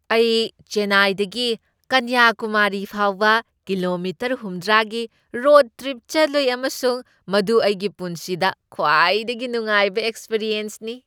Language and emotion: Manipuri, happy